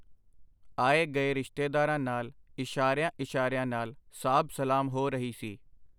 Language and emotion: Punjabi, neutral